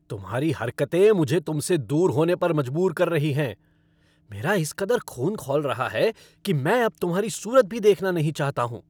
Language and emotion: Hindi, angry